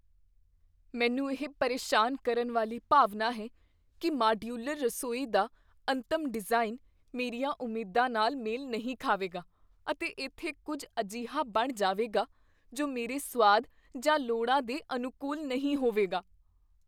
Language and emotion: Punjabi, fearful